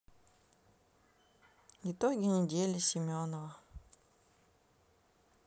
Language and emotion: Russian, neutral